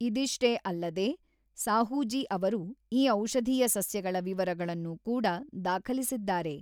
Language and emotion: Kannada, neutral